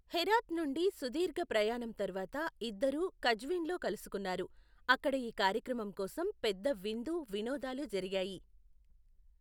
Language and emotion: Telugu, neutral